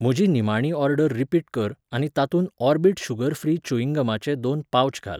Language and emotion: Goan Konkani, neutral